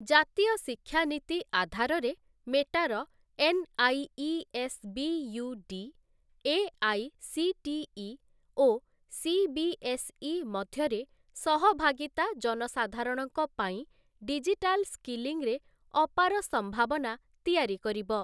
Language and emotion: Odia, neutral